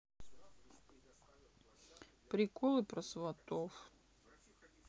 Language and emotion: Russian, sad